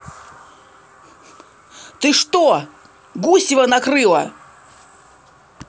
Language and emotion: Russian, angry